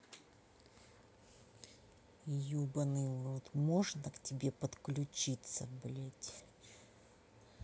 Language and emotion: Russian, angry